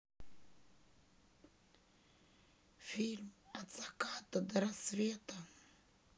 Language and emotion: Russian, sad